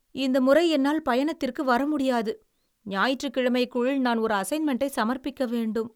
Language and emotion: Tamil, sad